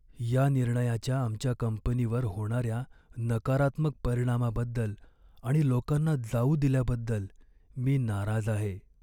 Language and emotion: Marathi, sad